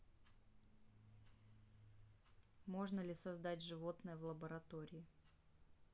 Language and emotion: Russian, neutral